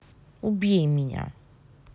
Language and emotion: Russian, angry